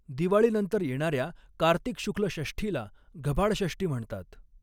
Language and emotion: Marathi, neutral